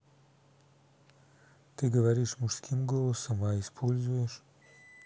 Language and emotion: Russian, neutral